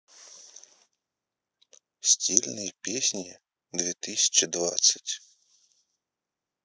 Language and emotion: Russian, neutral